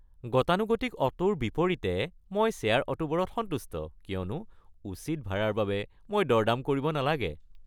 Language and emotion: Assamese, happy